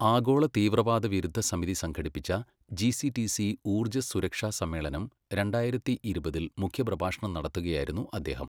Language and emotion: Malayalam, neutral